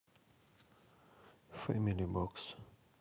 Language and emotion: Russian, neutral